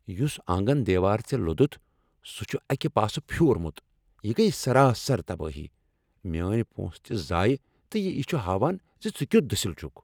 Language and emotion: Kashmiri, angry